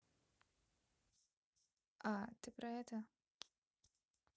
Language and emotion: Russian, neutral